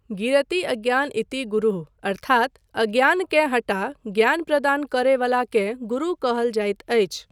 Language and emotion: Maithili, neutral